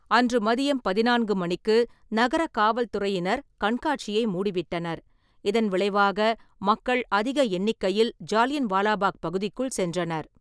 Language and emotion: Tamil, neutral